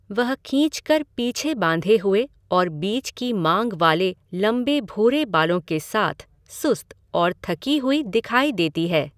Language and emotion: Hindi, neutral